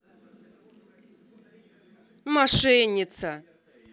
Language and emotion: Russian, angry